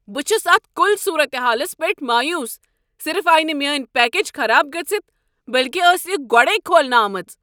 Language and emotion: Kashmiri, angry